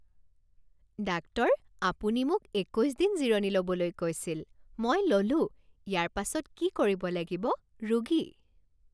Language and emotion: Assamese, happy